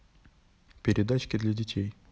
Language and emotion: Russian, neutral